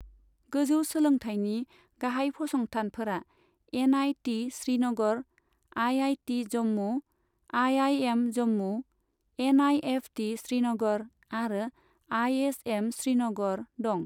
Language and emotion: Bodo, neutral